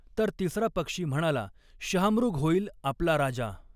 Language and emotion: Marathi, neutral